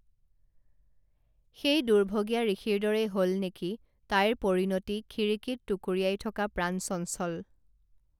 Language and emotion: Assamese, neutral